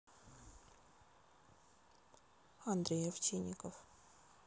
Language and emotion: Russian, neutral